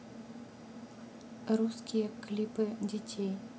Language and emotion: Russian, neutral